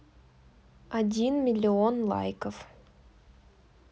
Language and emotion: Russian, neutral